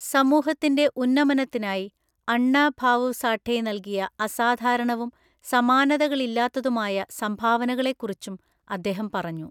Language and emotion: Malayalam, neutral